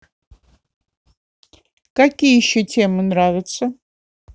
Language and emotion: Russian, neutral